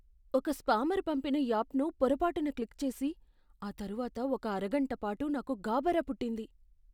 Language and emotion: Telugu, fearful